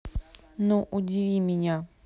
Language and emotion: Russian, neutral